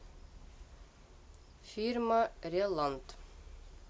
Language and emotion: Russian, neutral